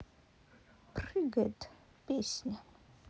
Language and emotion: Russian, sad